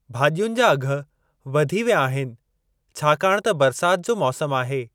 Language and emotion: Sindhi, neutral